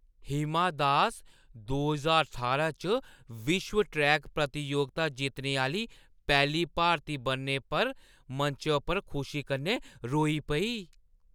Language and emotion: Dogri, happy